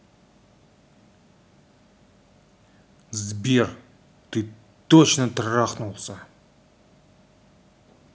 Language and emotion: Russian, angry